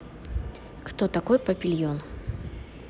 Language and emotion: Russian, neutral